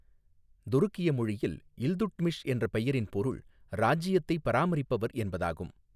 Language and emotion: Tamil, neutral